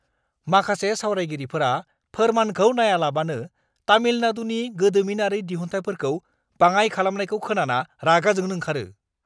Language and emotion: Bodo, angry